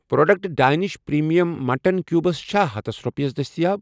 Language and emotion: Kashmiri, neutral